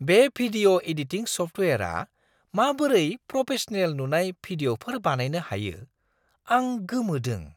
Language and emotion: Bodo, surprised